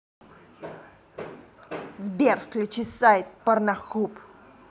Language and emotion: Russian, angry